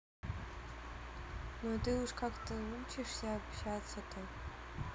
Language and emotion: Russian, neutral